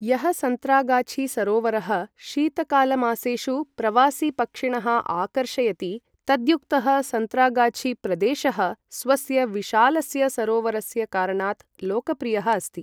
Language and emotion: Sanskrit, neutral